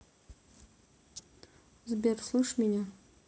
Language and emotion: Russian, neutral